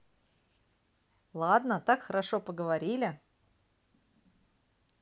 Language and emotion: Russian, positive